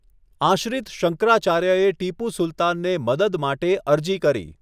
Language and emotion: Gujarati, neutral